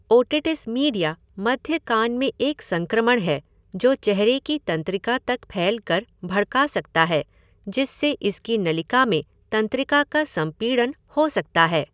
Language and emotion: Hindi, neutral